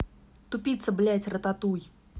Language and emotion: Russian, angry